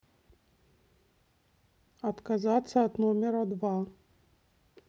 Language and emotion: Russian, neutral